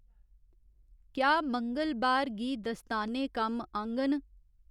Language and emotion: Dogri, neutral